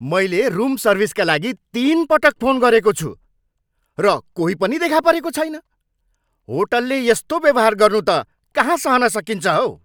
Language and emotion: Nepali, angry